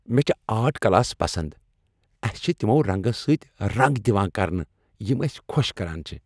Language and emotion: Kashmiri, happy